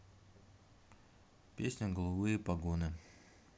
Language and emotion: Russian, neutral